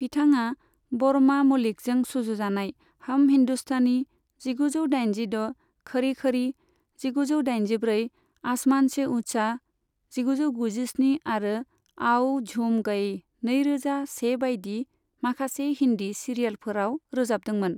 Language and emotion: Bodo, neutral